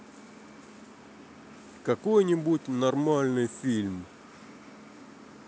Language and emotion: Russian, neutral